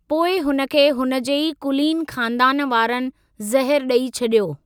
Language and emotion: Sindhi, neutral